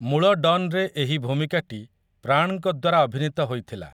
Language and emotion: Odia, neutral